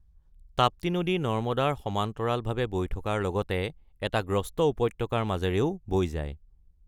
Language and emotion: Assamese, neutral